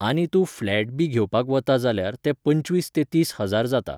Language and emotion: Goan Konkani, neutral